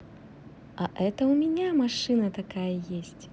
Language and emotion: Russian, positive